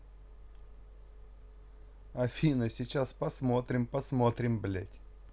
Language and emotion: Russian, neutral